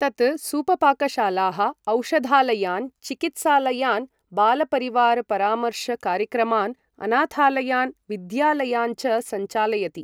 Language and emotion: Sanskrit, neutral